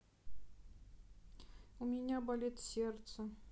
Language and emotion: Russian, sad